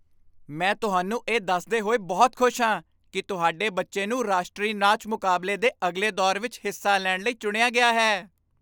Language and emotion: Punjabi, happy